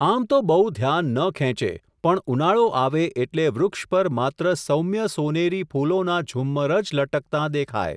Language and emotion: Gujarati, neutral